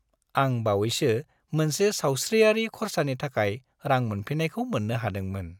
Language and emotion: Bodo, happy